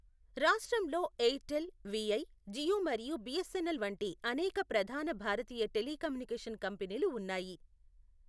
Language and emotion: Telugu, neutral